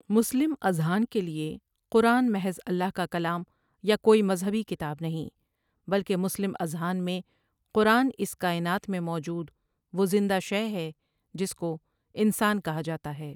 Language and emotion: Urdu, neutral